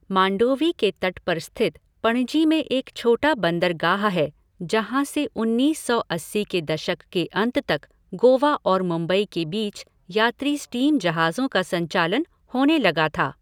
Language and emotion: Hindi, neutral